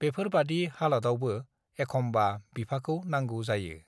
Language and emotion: Bodo, neutral